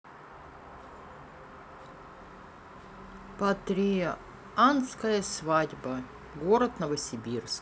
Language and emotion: Russian, neutral